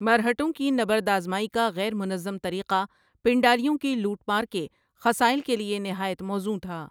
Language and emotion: Urdu, neutral